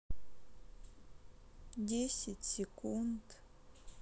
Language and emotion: Russian, sad